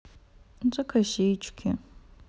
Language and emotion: Russian, sad